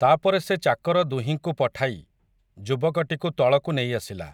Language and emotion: Odia, neutral